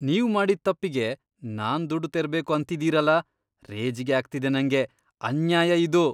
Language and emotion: Kannada, disgusted